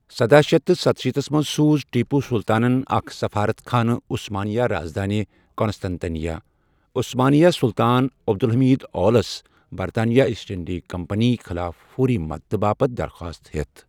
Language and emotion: Kashmiri, neutral